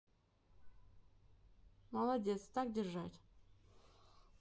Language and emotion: Russian, neutral